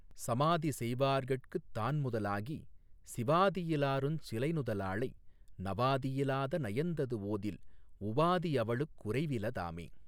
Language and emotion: Tamil, neutral